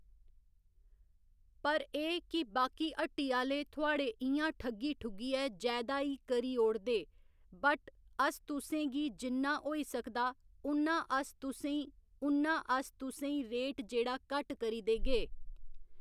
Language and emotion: Dogri, neutral